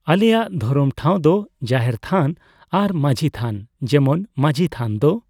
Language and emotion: Santali, neutral